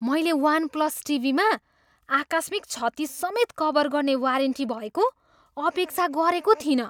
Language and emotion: Nepali, surprised